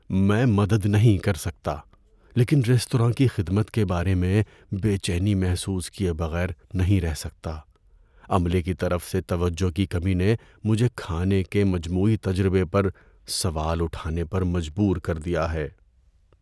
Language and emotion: Urdu, fearful